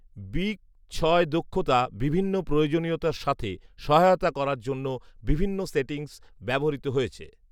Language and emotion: Bengali, neutral